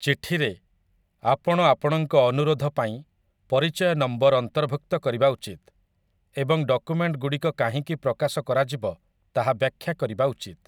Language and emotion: Odia, neutral